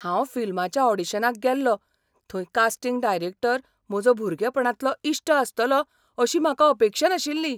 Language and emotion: Goan Konkani, surprised